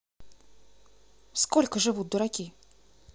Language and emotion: Russian, neutral